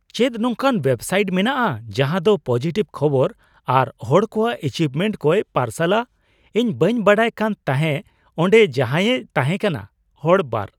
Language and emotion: Santali, surprised